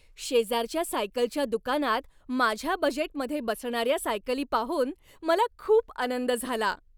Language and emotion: Marathi, happy